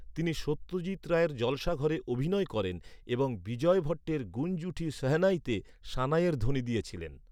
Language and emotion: Bengali, neutral